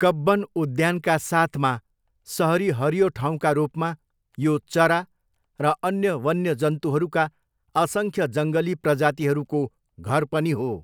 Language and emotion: Nepali, neutral